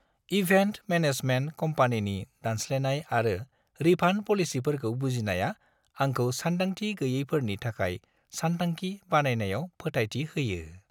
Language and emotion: Bodo, happy